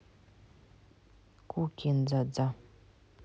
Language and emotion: Russian, neutral